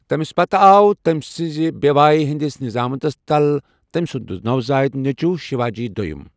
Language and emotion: Kashmiri, neutral